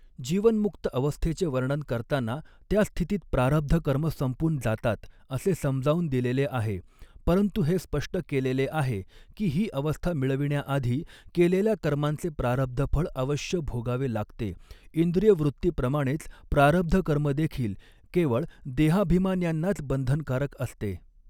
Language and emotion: Marathi, neutral